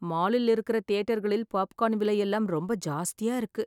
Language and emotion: Tamil, sad